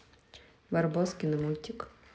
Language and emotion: Russian, neutral